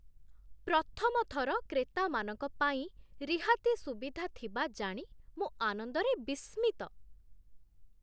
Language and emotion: Odia, surprised